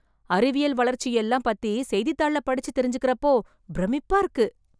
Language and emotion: Tamil, surprised